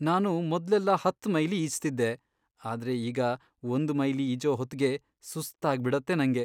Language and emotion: Kannada, sad